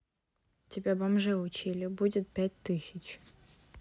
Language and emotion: Russian, neutral